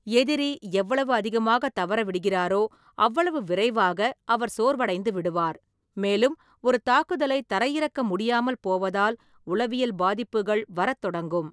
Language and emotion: Tamil, neutral